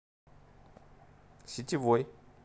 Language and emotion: Russian, neutral